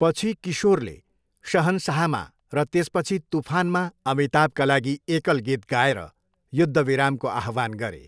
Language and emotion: Nepali, neutral